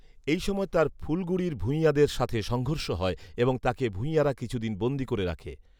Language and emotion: Bengali, neutral